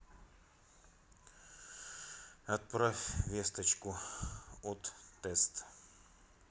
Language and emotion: Russian, neutral